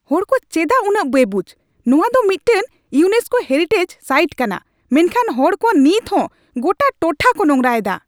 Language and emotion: Santali, angry